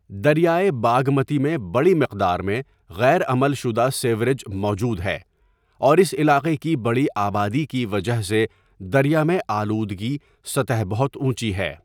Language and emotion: Urdu, neutral